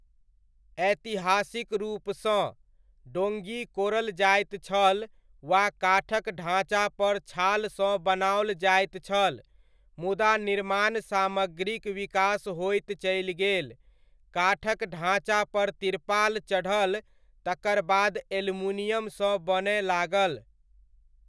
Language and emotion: Maithili, neutral